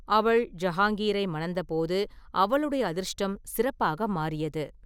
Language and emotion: Tamil, neutral